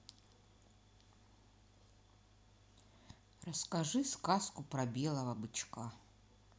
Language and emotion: Russian, neutral